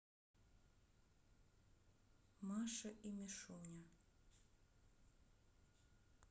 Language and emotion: Russian, neutral